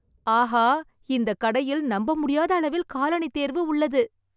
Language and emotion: Tamil, surprised